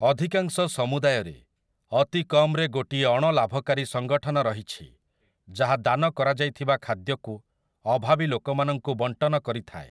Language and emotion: Odia, neutral